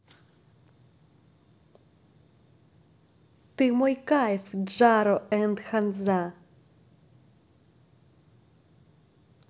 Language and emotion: Russian, positive